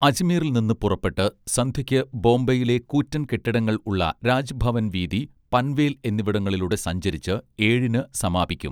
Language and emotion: Malayalam, neutral